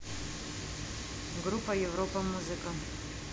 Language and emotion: Russian, neutral